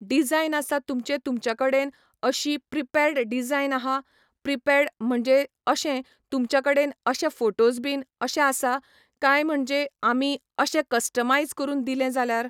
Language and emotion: Goan Konkani, neutral